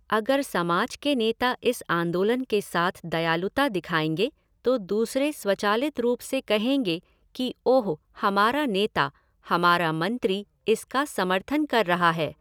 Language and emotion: Hindi, neutral